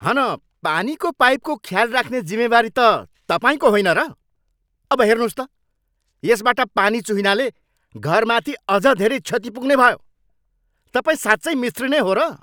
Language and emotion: Nepali, angry